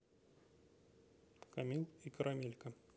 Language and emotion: Russian, neutral